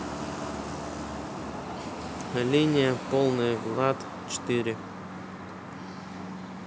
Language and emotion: Russian, neutral